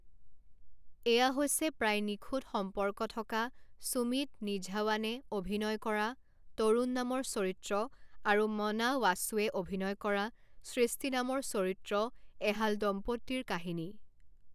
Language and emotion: Assamese, neutral